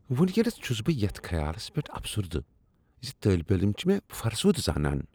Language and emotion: Kashmiri, disgusted